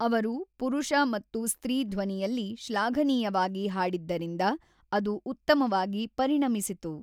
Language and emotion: Kannada, neutral